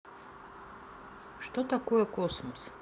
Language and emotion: Russian, neutral